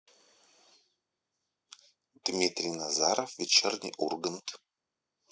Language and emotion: Russian, neutral